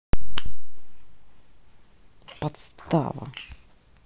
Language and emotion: Russian, angry